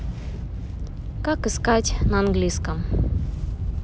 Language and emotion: Russian, neutral